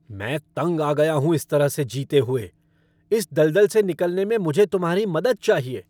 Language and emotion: Hindi, angry